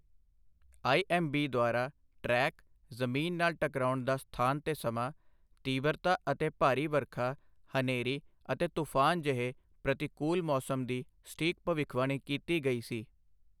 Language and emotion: Punjabi, neutral